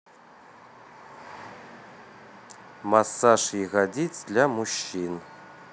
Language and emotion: Russian, neutral